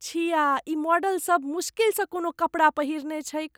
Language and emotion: Maithili, disgusted